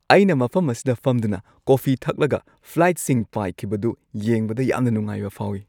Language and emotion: Manipuri, happy